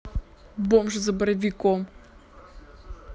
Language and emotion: Russian, neutral